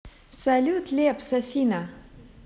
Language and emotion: Russian, positive